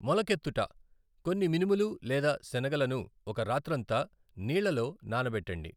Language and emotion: Telugu, neutral